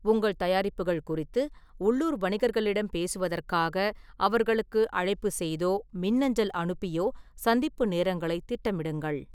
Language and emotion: Tamil, neutral